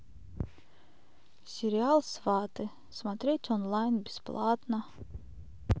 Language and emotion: Russian, sad